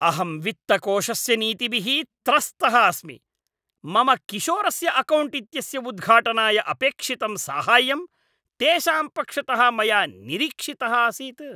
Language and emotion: Sanskrit, angry